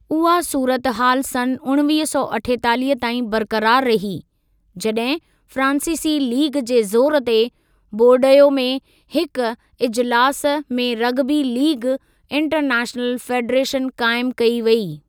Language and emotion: Sindhi, neutral